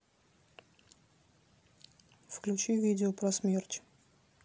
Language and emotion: Russian, neutral